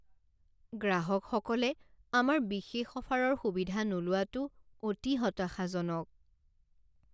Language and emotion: Assamese, sad